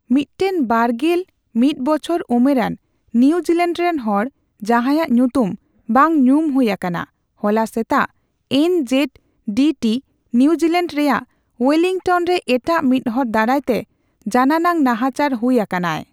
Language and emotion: Santali, neutral